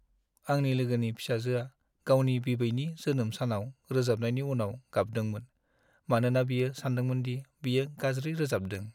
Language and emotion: Bodo, sad